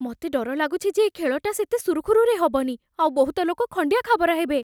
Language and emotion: Odia, fearful